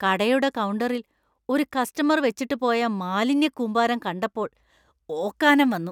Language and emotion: Malayalam, disgusted